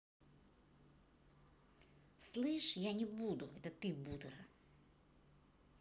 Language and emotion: Russian, angry